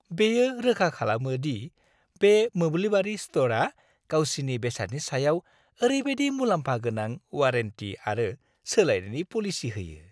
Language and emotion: Bodo, happy